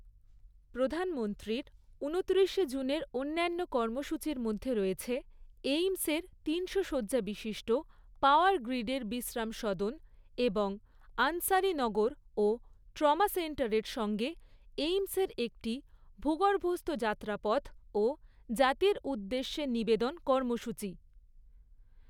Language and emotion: Bengali, neutral